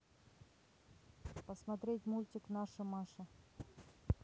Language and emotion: Russian, neutral